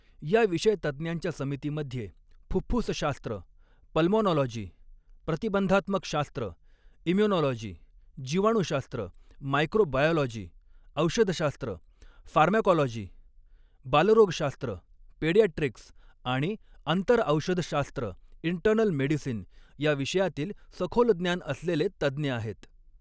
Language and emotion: Marathi, neutral